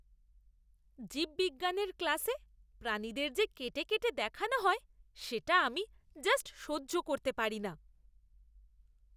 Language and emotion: Bengali, disgusted